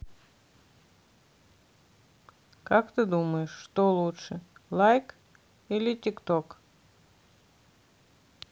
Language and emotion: Russian, neutral